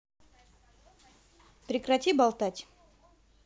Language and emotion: Russian, angry